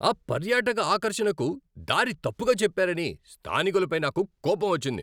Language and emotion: Telugu, angry